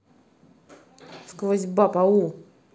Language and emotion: Russian, angry